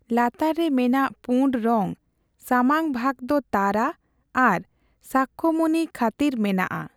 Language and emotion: Santali, neutral